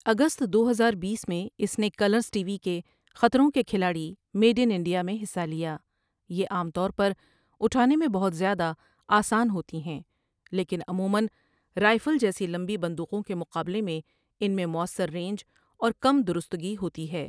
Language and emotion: Urdu, neutral